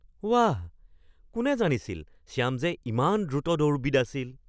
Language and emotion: Assamese, surprised